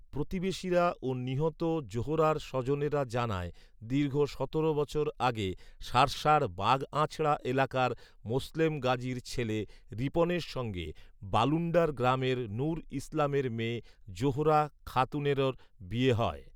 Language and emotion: Bengali, neutral